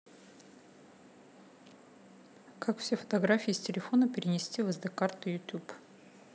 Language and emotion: Russian, neutral